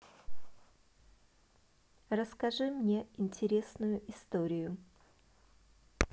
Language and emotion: Russian, positive